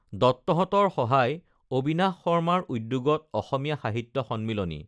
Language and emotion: Assamese, neutral